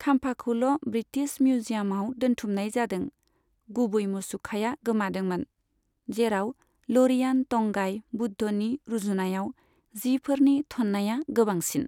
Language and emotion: Bodo, neutral